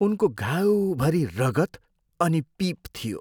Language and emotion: Nepali, disgusted